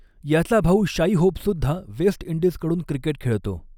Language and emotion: Marathi, neutral